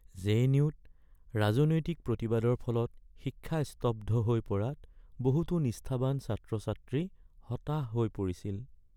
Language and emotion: Assamese, sad